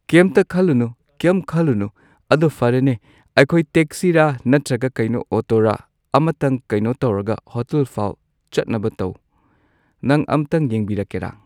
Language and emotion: Manipuri, neutral